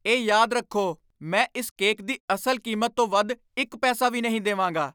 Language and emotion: Punjabi, angry